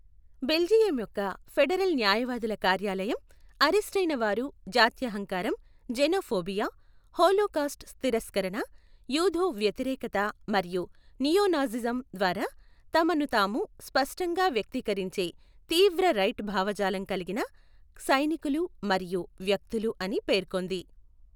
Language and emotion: Telugu, neutral